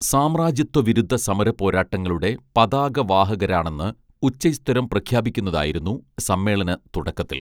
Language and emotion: Malayalam, neutral